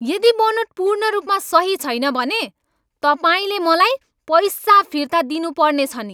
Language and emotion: Nepali, angry